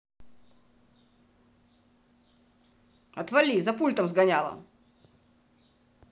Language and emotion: Russian, angry